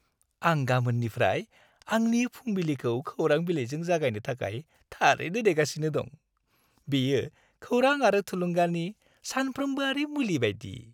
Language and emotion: Bodo, happy